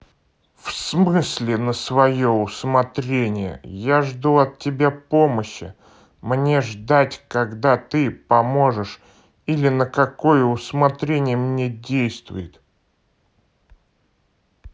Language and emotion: Russian, neutral